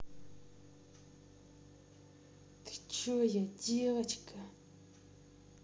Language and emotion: Russian, angry